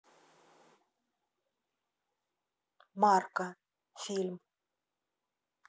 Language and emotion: Russian, neutral